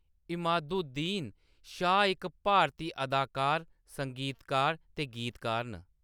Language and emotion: Dogri, neutral